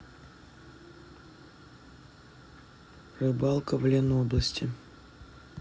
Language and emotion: Russian, neutral